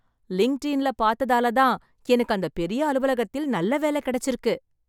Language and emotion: Tamil, happy